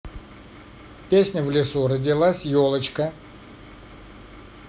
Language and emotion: Russian, neutral